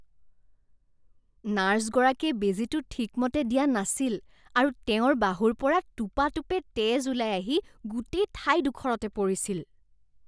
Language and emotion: Assamese, disgusted